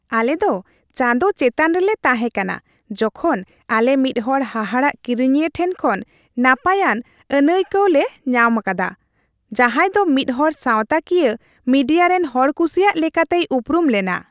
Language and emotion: Santali, happy